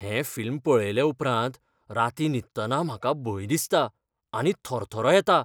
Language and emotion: Goan Konkani, fearful